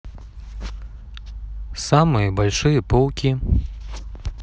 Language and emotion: Russian, neutral